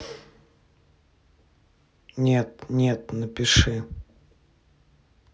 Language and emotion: Russian, neutral